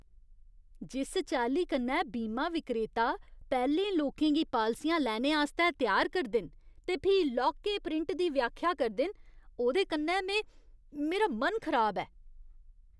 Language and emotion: Dogri, disgusted